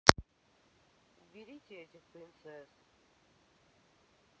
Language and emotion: Russian, neutral